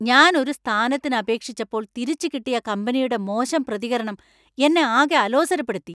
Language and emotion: Malayalam, angry